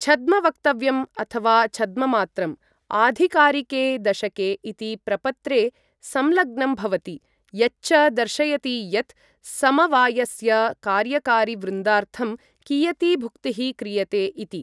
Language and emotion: Sanskrit, neutral